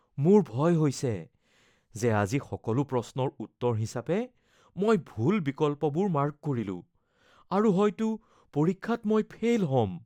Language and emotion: Assamese, fearful